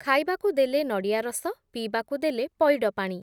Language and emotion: Odia, neutral